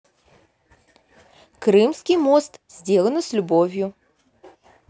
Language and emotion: Russian, positive